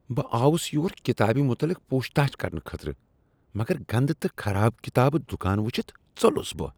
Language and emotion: Kashmiri, disgusted